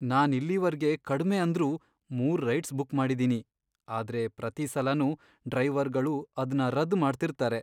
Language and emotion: Kannada, sad